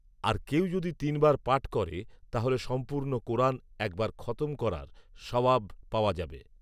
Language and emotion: Bengali, neutral